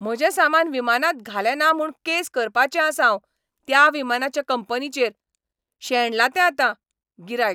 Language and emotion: Goan Konkani, angry